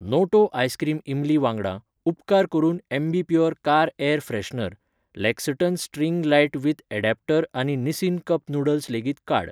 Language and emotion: Goan Konkani, neutral